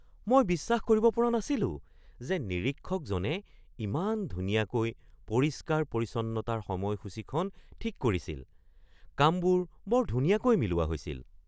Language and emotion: Assamese, surprised